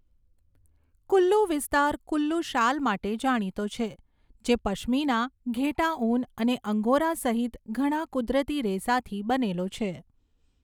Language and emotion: Gujarati, neutral